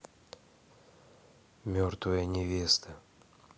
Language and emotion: Russian, neutral